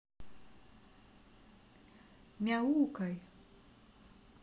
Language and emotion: Russian, neutral